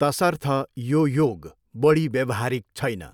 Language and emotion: Nepali, neutral